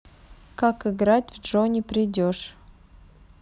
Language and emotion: Russian, neutral